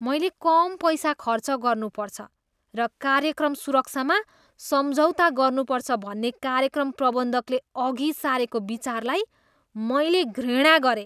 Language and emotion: Nepali, disgusted